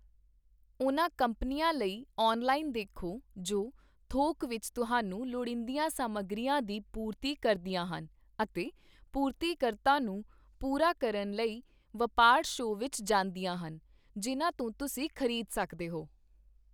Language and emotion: Punjabi, neutral